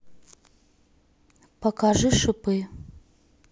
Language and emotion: Russian, neutral